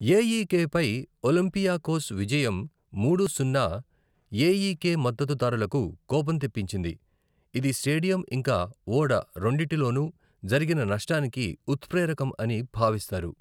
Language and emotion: Telugu, neutral